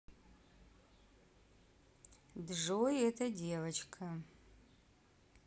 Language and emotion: Russian, neutral